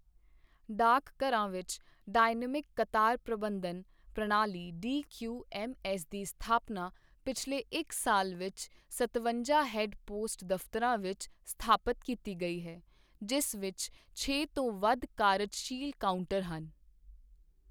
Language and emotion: Punjabi, neutral